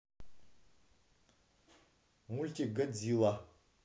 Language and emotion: Russian, neutral